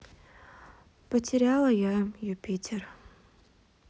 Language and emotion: Russian, sad